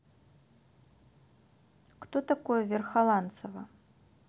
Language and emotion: Russian, neutral